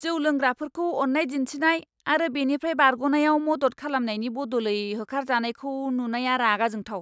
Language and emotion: Bodo, angry